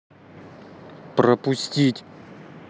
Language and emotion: Russian, angry